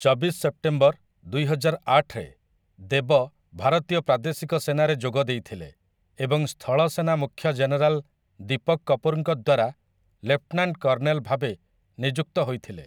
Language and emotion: Odia, neutral